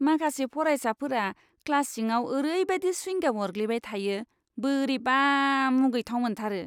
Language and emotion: Bodo, disgusted